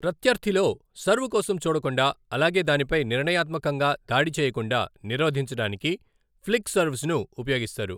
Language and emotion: Telugu, neutral